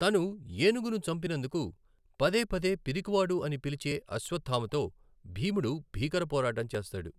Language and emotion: Telugu, neutral